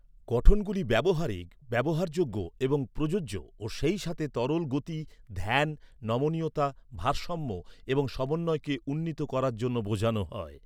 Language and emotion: Bengali, neutral